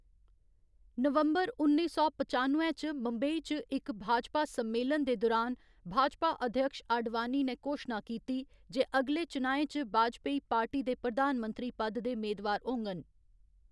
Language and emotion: Dogri, neutral